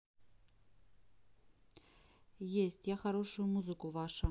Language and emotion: Russian, neutral